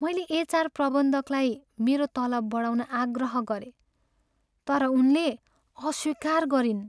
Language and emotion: Nepali, sad